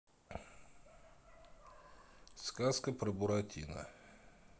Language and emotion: Russian, neutral